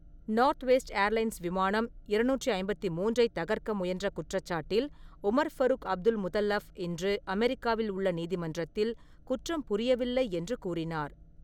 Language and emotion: Tamil, neutral